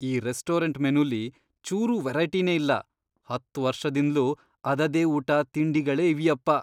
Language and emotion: Kannada, disgusted